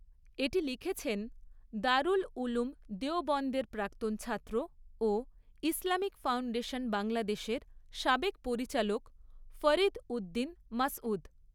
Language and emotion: Bengali, neutral